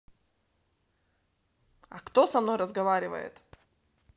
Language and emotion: Russian, neutral